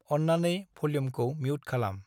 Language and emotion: Bodo, neutral